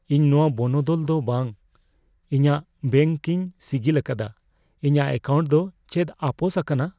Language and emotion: Santali, fearful